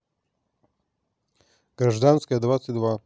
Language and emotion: Russian, neutral